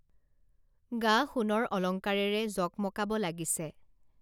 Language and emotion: Assamese, neutral